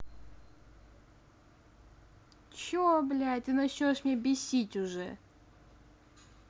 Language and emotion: Russian, angry